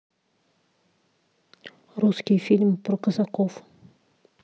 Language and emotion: Russian, neutral